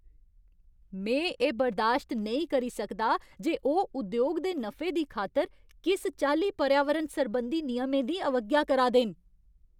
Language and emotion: Dogri, angry